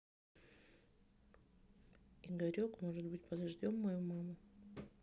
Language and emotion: Russian, neutral